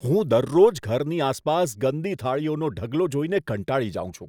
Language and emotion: Gujarati, disgusted